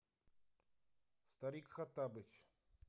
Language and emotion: Russian, neutral